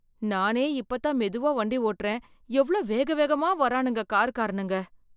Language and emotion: Tamil, fearful